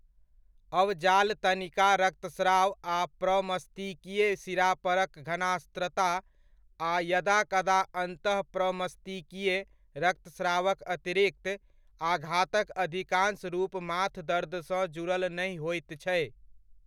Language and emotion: Maithili, neutral